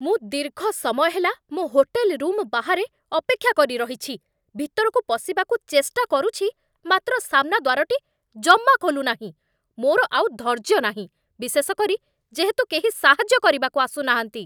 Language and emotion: Odia, angry